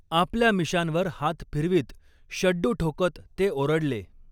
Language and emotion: Marathi, neutral